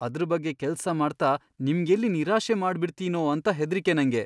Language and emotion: Kannada, fearful